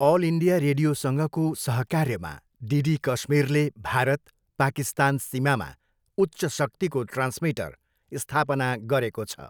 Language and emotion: Nepali, neutral